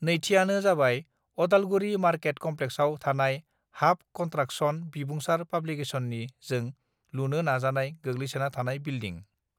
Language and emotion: Bodo, neutral